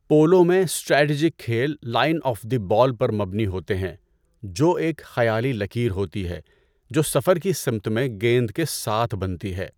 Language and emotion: Urdu, neutral